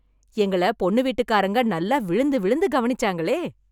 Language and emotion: Tamil, happy